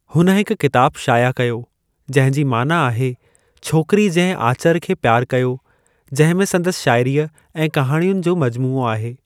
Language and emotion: Sindhi, neutral